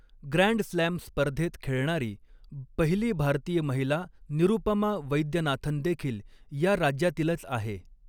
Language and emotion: Marathi, neutral